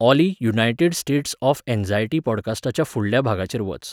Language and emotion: Goan Konkani, neutral